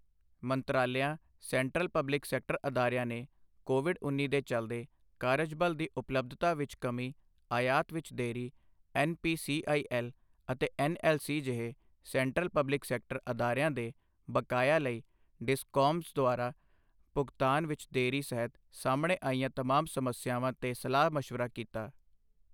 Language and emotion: Punjabi, neutral